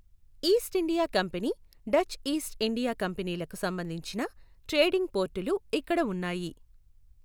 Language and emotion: Telugu, neutral